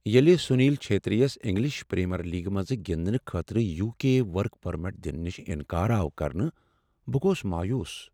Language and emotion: Kashmiri, sad